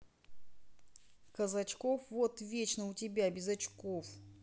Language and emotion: Russian, neutral